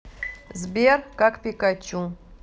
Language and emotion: Russian, neutral